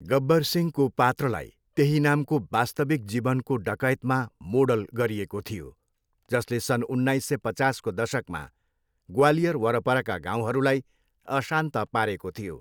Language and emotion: Nepali, neutral